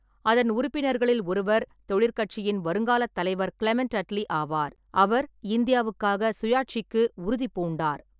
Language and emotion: Tamil, neutral